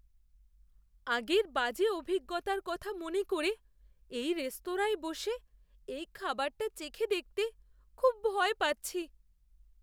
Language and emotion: Bengali, fearful